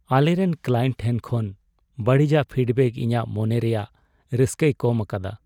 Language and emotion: Santali, sad